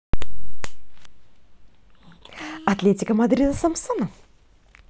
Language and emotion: Russian, positive